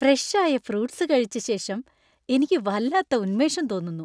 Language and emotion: Malayalam, happy